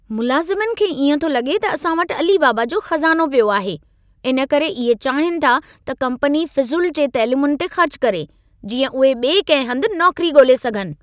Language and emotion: Sindhi, angry